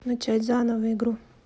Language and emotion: Russian, neutral